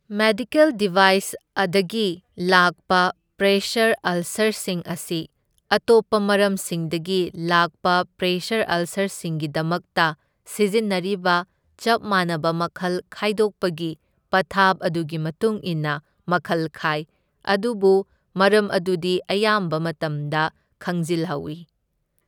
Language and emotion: Manipuri, neutral